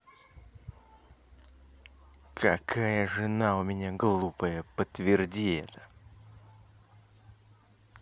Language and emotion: Russian, angry